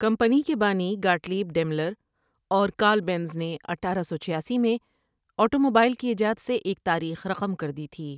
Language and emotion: Urdu, neutral